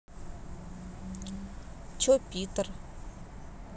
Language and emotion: Russian, neutral